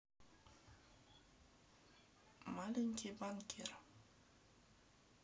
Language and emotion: Russian, neutral